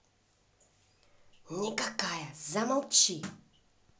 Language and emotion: Russian, angry